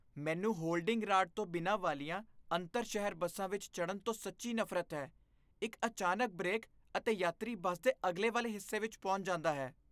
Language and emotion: Punjabi, disgusted